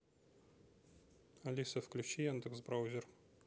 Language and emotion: Russian, neutral